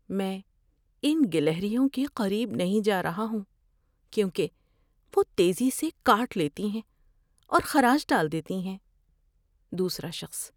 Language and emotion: Urdu, fearful